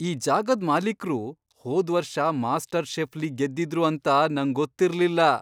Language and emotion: Kannada, surprised